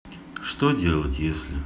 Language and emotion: Russian, neutral